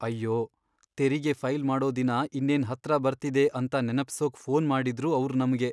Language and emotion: Kannada, sad